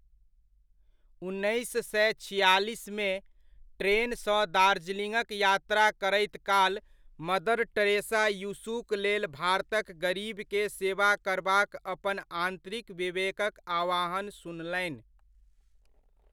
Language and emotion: Maithili, neutral